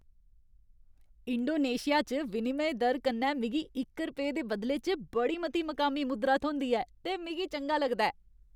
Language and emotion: Dogri, happy